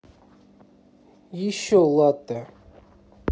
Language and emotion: Russian, neutral